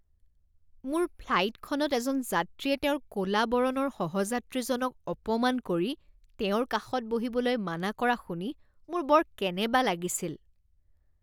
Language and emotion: Assamese, disgusted